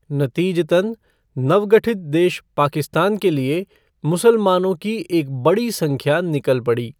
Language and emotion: Hindi, neutral